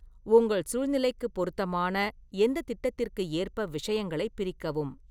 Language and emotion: Tamil, neutral